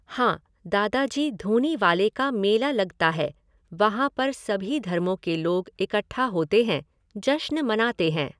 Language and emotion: Hindi, neutral